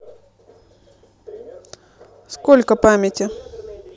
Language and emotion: Russian, neutral